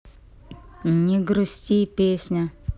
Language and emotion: Russian, neutral